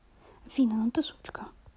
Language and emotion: Russian, neutral